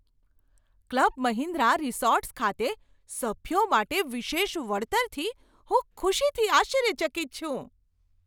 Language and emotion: Gujarati, surprised